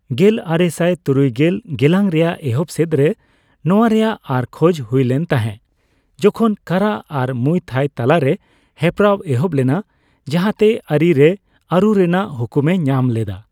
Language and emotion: Santali, neutral